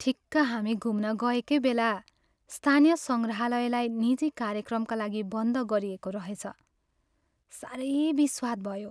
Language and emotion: Nepali, sad